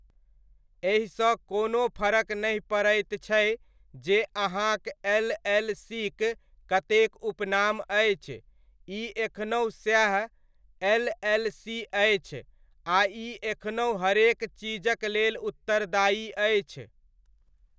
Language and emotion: Maithili, neutral